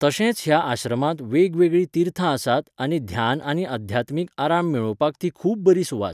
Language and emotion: Goan Konkani, neutral